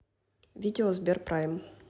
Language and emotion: Russian, neutral